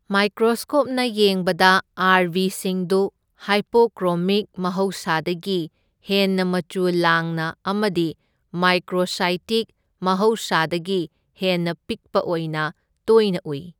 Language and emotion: Manipuri, neutral